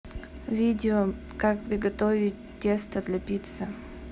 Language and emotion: Russian, neutral